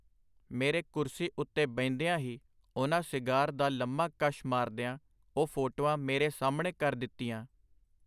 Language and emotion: Punjabi, neutral